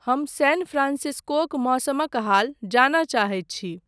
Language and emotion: Maithili, neutral